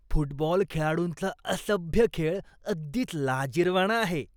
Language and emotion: Marathi, disgusted